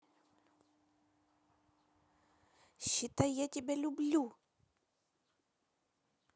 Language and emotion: Russian, positive